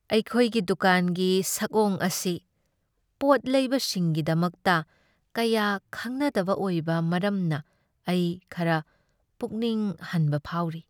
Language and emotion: Manipuri, sad